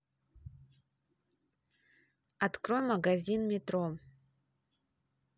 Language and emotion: Russian, neutral